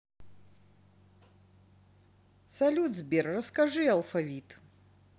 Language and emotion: Russian, positive